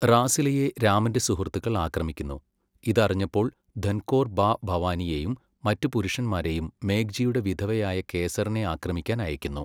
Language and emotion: Malayalam, neutral